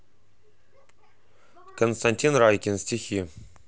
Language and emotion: Russian, neutral